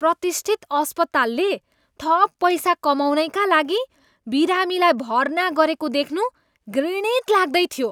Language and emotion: Nepali, disgusted